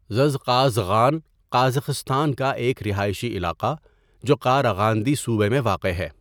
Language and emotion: Urdu, neutral